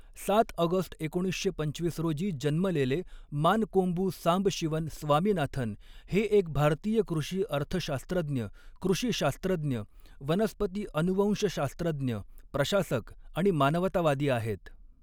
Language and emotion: Marathi, neutral